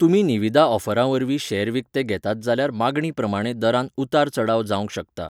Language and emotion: Goan Konkani, neutral